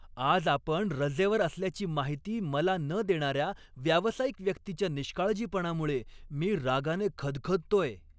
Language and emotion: Marathi, angry